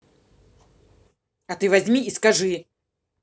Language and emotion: Russian, angry